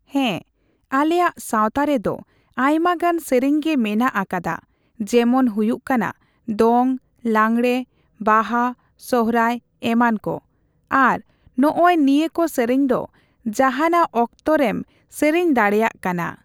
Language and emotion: Santali, neutral